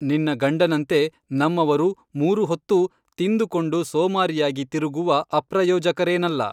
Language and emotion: Kannada, neutral